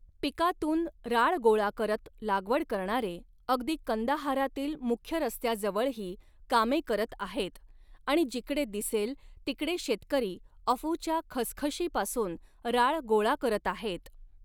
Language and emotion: Marathi, neutral